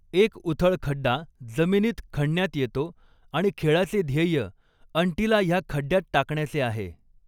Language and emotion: Marathi, neutral